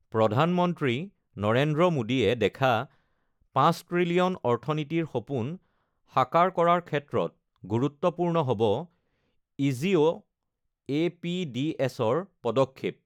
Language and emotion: Assamese, neutral